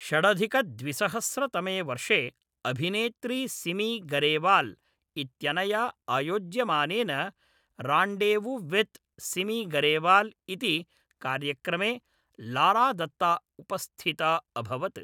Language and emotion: Sanskrit, neutral